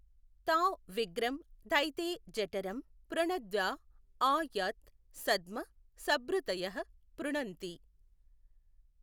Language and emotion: Telugu, neutral